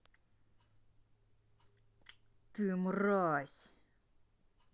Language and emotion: Russian, angry